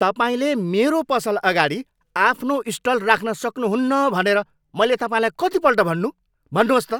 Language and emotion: Nepali, angry